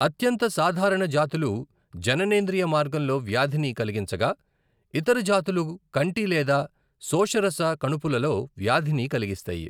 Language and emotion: Telugu, neutral